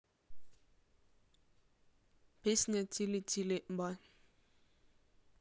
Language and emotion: Russian, neutral